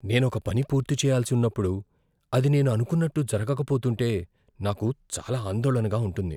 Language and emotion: Telugu, fearful